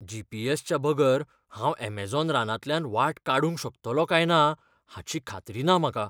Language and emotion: Goan Konkani, fearful